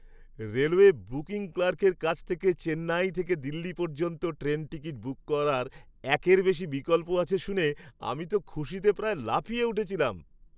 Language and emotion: Bengali, happy